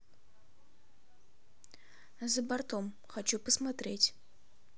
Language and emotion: Russian, neutral